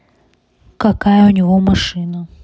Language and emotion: Russian, neutral